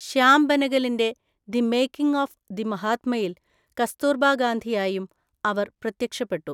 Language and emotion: Malayalam, neutral